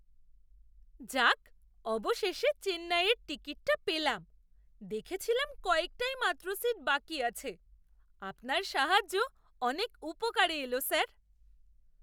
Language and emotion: Bengali, surprised